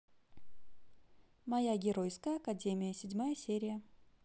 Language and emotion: Russian, positive